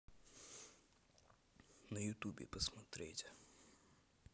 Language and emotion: Russian, neutral